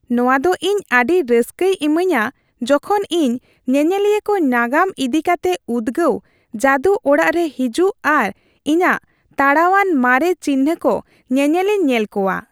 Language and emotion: Santali, happy